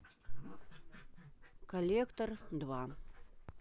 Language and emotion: Russian, neutral